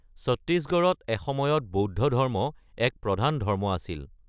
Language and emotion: Assamese, neutral